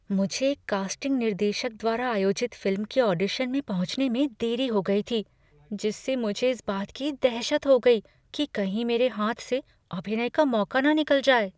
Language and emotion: Hindi, fearful